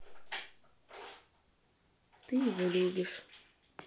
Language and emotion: Russian, sad